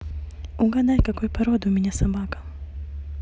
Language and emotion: Russian, neutral